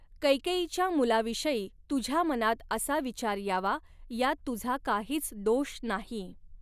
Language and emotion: Marathi, neutral